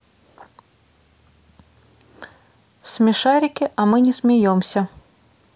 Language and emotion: Russian, neutral